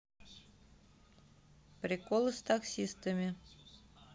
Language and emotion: Russian, neutral